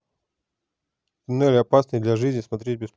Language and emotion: Russian, neutral